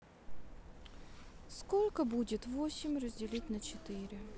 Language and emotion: Russian, sad